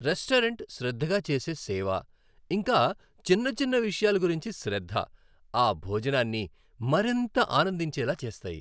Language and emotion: Telugu, happy